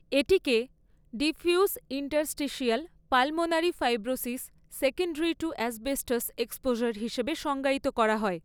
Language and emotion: Bengali, neutral